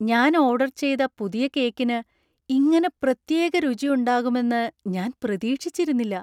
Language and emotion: Malayalam, surprised